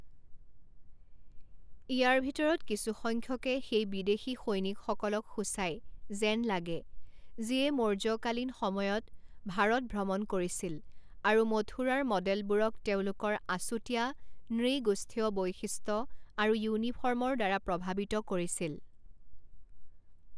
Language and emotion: Assamese, neutral